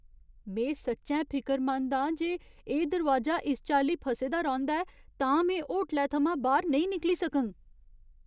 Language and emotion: Dogri, fearful